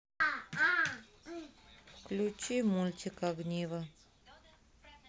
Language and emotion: Russian, neutral